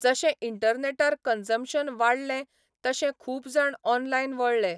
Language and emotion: Goan Konkani, neutral